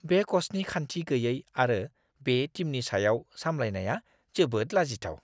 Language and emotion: Bodo, disgusted